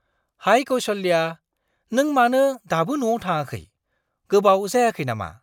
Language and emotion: Bodo, surprised